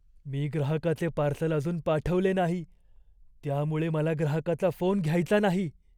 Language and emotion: Marathi, fearful